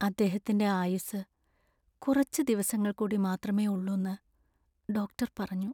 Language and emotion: Malayalam, sad